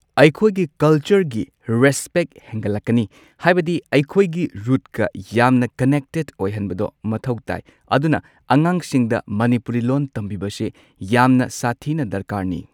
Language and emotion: Manipuri, neutral